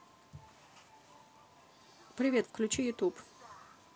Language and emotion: Russian, neutral